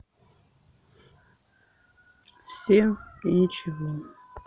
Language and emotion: Russian, sad